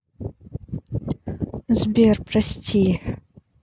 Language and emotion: Russian, neutral